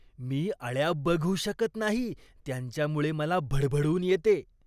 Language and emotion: Marathi, disgusted